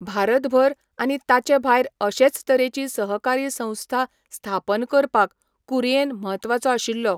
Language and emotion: Goan Konkani, neutral